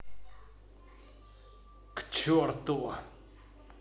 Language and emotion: Russian, angry